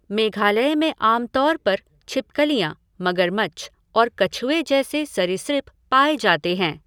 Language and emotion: Hindi, neutral